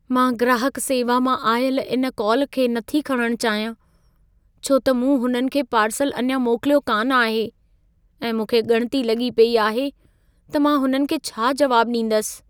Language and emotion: Sindhi, fearful